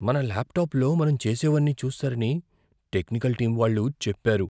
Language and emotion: Telugu, fearful